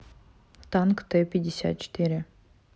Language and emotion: Russian, neutral